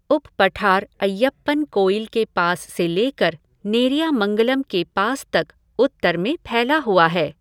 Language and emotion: Hindi, neutral